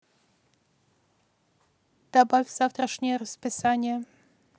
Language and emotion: Russian, neutral